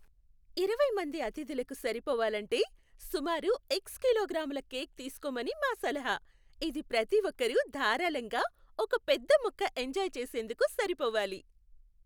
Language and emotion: Telugu, happy